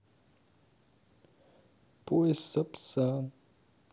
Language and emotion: Russian, sad